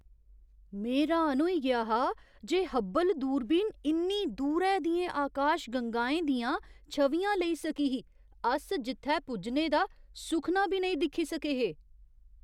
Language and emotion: Dogri, surprised